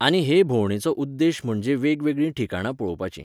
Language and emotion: Goan Konkani, neutral